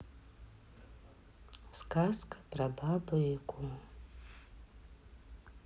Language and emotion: Russian, sad